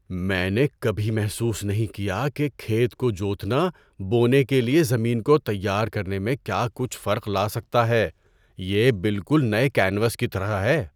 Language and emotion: Urdu, surprised